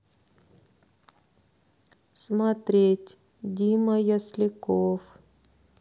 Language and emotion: Russian, sad